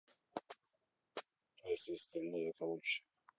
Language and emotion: Russian, neutral